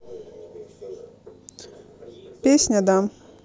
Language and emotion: Russian, neutral